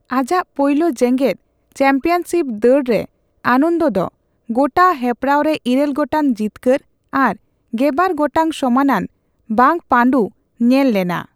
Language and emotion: Santali, neutral